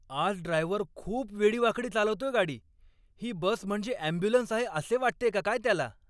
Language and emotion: Marathi, angry